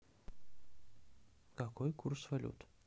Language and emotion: Russian, neutral